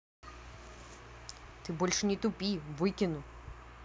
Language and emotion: Russian, angry